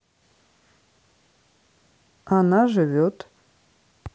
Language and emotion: Russian, neutral